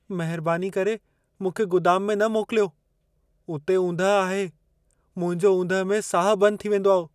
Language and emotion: Sindhi, fearful